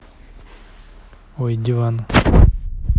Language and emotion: Russian, neutral